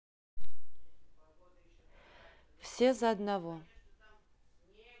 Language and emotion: Russian, neutral